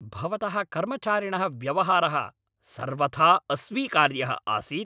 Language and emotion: Sanskrit, angry